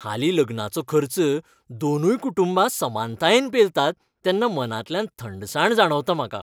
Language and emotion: Goan Konkani, happy